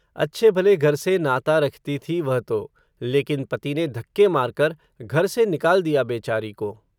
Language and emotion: Hindi, neutral